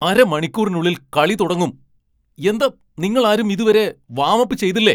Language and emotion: Malayalam, angry